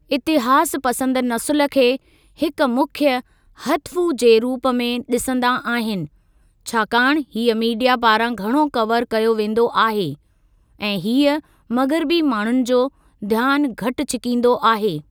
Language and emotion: Sindhi, neutral